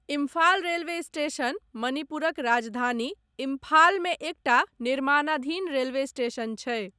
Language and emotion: Maithili, neutral